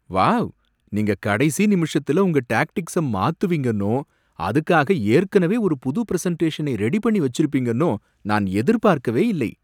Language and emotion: Tamil, surprised